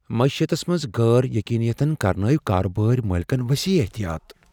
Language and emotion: Kashmiri, fearful